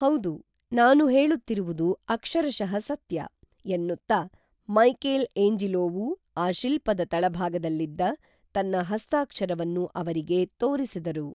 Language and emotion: Kannada, neutral